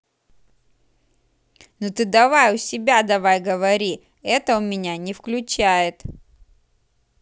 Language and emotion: Russian, angry